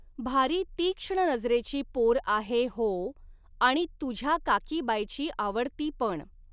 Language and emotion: Marathi, neutral